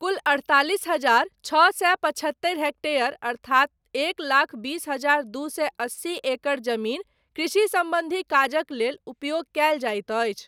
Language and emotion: Maithili, neutral